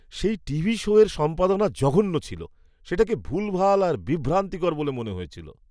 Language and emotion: Bengali, disgusted